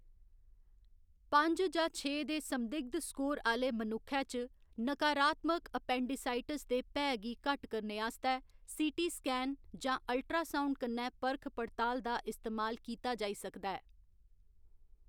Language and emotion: Dogri, neutral